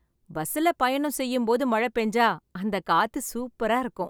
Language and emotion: Tamil, happy